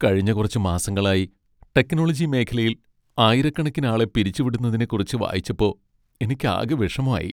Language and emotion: Malayalam, sad